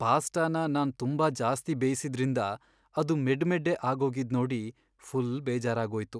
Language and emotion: Kannada, sad